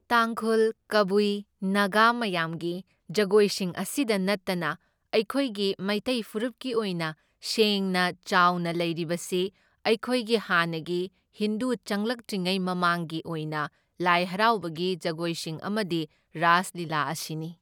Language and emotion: Manipuri, neutral